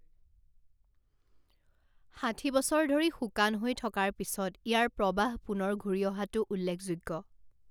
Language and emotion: Assamese, neutral